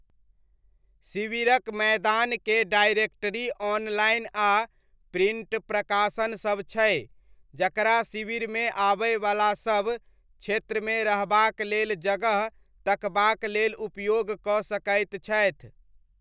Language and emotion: Maithili, neutral